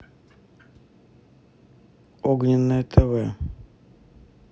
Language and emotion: Russian, neutral